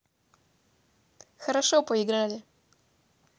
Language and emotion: Russian, positive